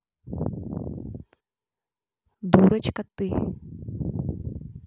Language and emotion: Russian, neutral